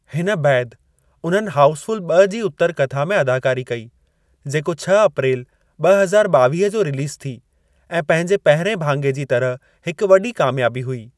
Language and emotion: Sindhi, neutral